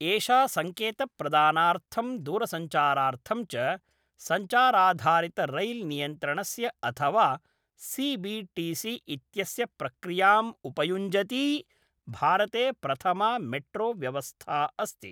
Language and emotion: Sanskrit, neutral